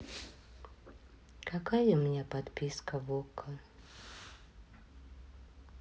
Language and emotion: Russian, sad